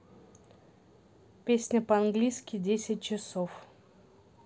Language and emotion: Russian, neutral